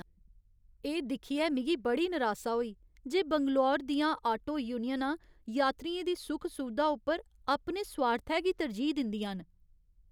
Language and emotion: Dogri, sad